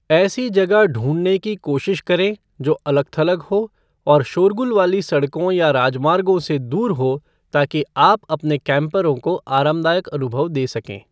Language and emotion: Hindi, neutral